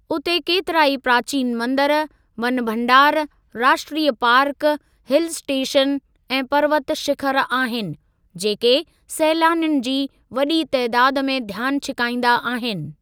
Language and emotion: Sindhi, neutral